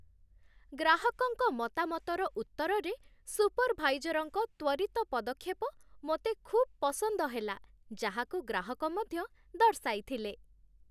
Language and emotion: Odia, happy